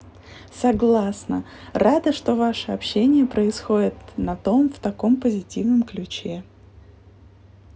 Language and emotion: Russian, positive